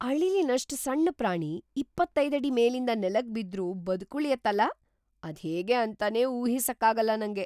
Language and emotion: Kannada, surprised